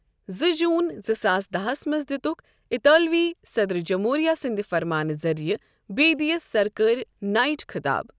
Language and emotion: Kashmiri, neutral